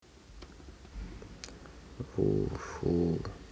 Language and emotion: Russian, sad